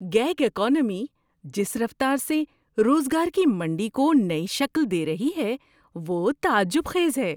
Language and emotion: Urdu, surprised